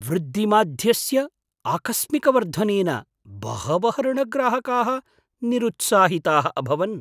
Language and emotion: Sanskrit, surprised